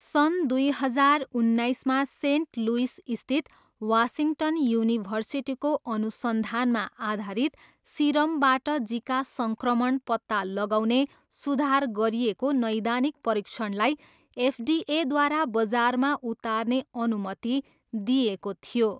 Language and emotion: Nepali, neutral